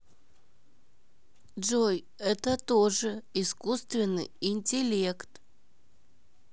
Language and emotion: Russian, neutral